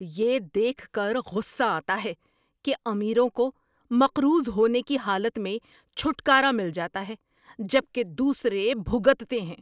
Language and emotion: Urdu, angry